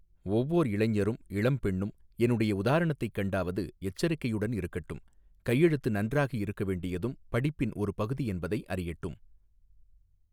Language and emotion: Tamil, neutral